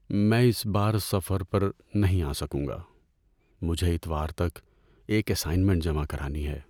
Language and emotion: Urdu, sad